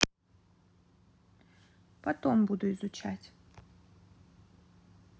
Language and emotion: Russian, neutral